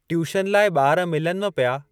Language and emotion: Sindhi, neutral